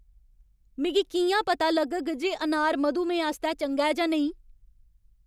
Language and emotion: Dogri, angry